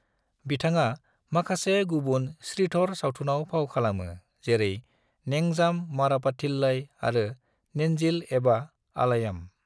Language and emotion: Bodo, neutral